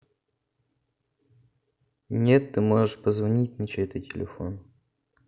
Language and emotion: Russian, neutral